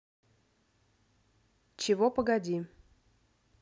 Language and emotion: Russian, neutral